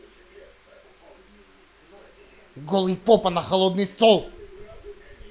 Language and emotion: Russian, angry